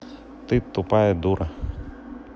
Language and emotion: Russian, neutral